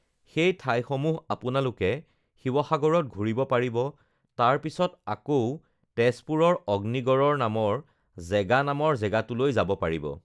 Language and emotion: Assamese, neutral